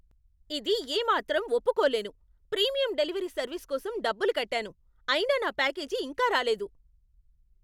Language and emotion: Telugu, angry